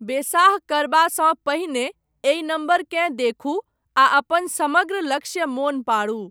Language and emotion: Maithili, neutral